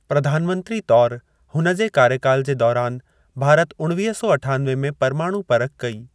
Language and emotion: Sindhi, neutral